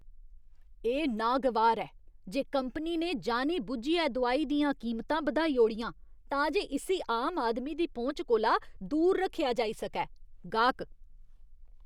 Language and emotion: Dogri, disgusted